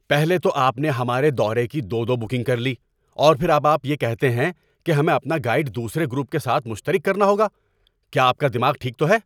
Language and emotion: Urdu, angry